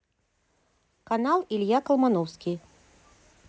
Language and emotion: Russian, neutral